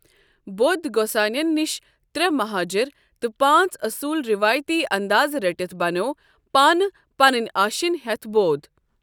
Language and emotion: Kashmiri, neutral